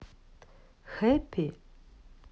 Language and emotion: Russian, neutral